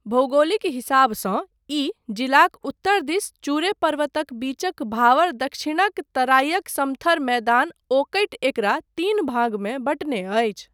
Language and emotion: Maithili, neutral